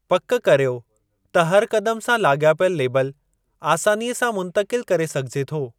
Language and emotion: Sindhi, neutral